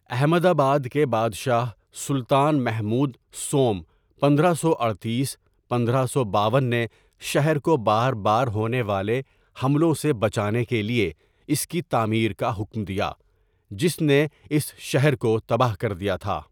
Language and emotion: Urdu, neutral